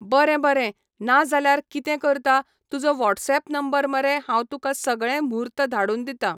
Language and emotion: Goan Konkani, neutral